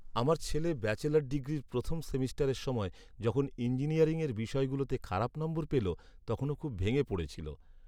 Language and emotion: Bengali, sad